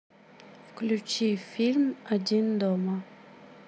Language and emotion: Russian, neutral